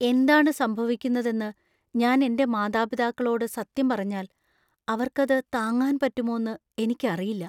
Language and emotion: Malayalam, fearful